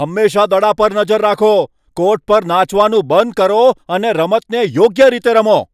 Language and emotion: Gujarati, angry